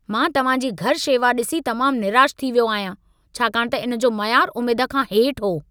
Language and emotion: Sindhi, angry